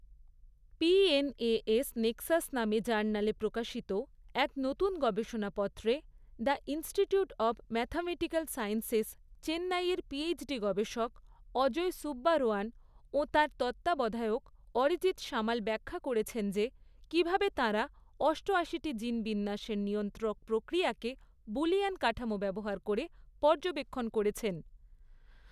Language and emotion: Bengali, neutral